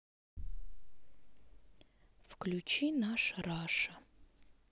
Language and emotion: Russian, sad